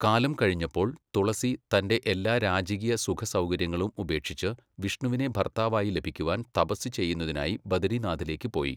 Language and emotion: Malayalam, neutral